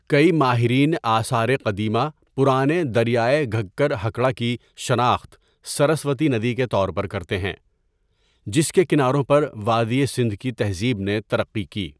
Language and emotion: Urdu, neutral